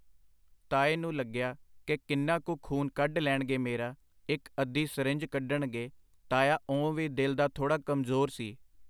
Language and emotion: Punjabi, neutral